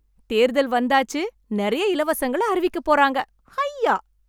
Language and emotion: Tamil, happy